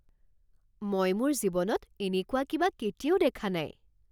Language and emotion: Assamese, surprised